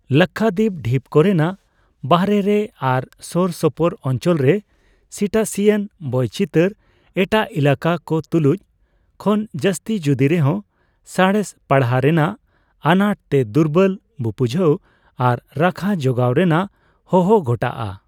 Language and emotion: Santali, neutral